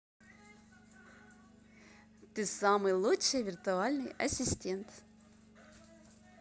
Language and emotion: Russian, positive